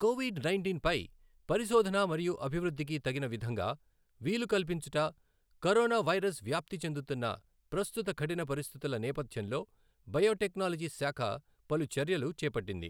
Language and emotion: Telugu, neutral